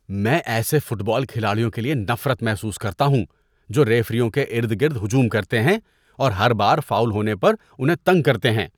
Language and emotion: Urdu, disgusted